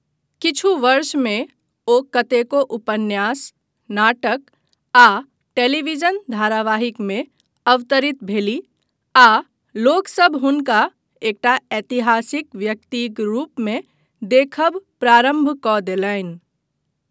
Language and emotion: Maithili, neutral